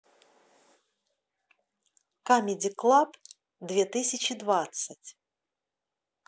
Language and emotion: Russian, positive